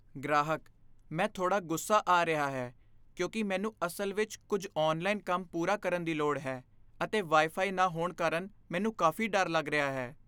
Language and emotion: Punjabi, fearful